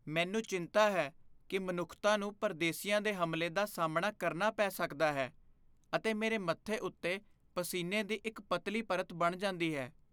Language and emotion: Punjabi, fearful